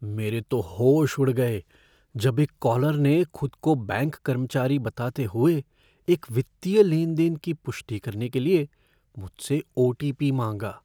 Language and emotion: Hindi, fearful